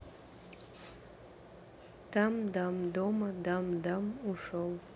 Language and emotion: Russian, neutral